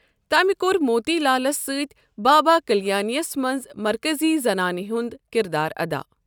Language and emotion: Kashmiri, neutral